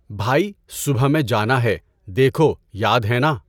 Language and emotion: Urdu, neutral